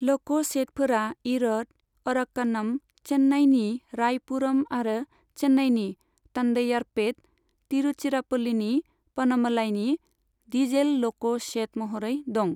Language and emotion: Bodo, neutral